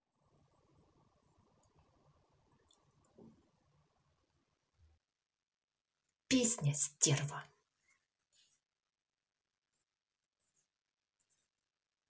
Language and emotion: Russian, angry